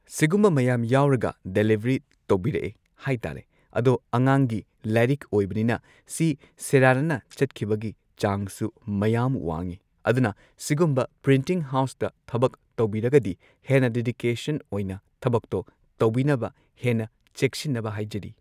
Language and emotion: Manipuri, neutral